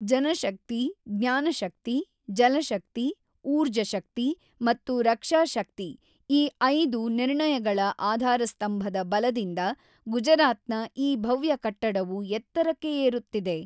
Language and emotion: Kannada, neutral